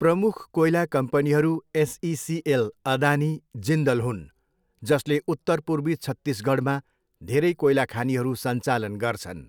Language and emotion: Nepali, neutral